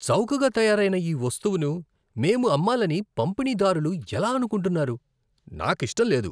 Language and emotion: Telugu, disgusted